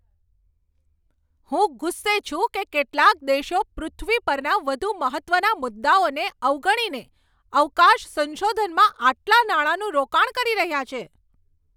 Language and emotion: Gujarati, angry